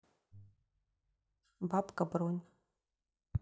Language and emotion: Russian, neutral